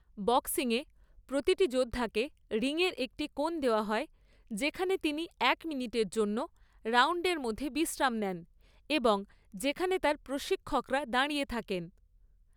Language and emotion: Bengali, neutral